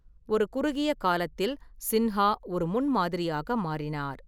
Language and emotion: Tamil, neutral